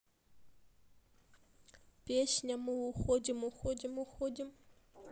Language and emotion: Russian, sad